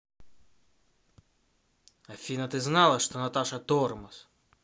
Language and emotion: Russian, angry